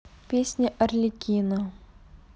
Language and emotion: Russian, neutral